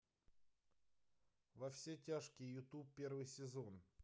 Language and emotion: Russian, neutral